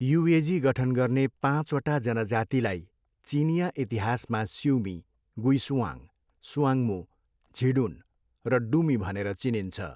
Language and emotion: Nepali, neutral